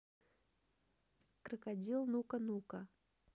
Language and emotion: Russian, neutral